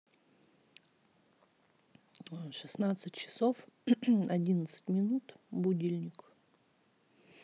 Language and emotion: Russian, neutral